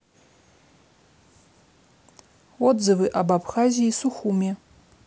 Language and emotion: Russian, neutral